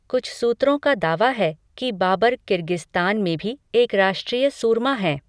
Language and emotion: Hindi, neutral